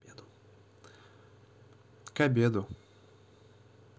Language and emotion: Russian, neutral